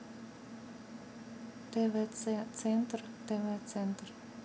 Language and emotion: Russian, neutral